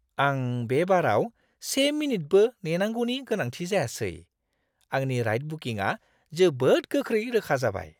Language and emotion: Bodo, surprised